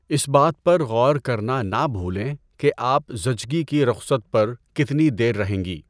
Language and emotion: Urdu, neutral